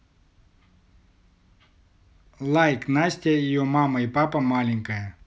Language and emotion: Russian, neutral